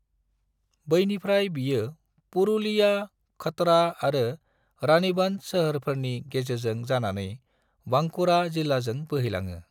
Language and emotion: Bodo, neutral